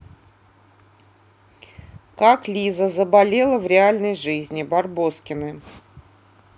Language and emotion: Russian, neutral